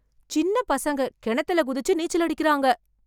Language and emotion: Tamil, surprised